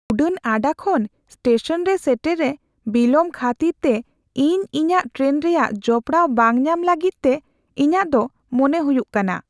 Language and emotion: Santali, fearful